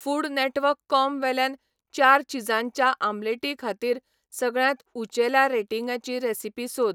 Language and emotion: Goan Konkani, neutral